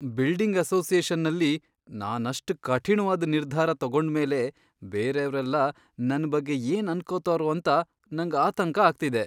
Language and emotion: Kannada, fearful